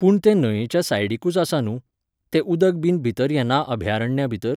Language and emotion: Goan Konkani, neutral